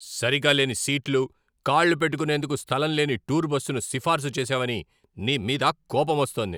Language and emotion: Telugu, angry